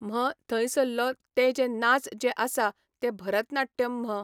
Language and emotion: Goan Konkani, neutral